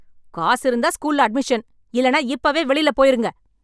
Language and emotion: Tamil, angry